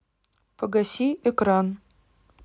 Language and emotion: Russian, neutral